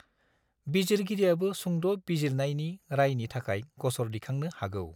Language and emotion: Bodo, neutral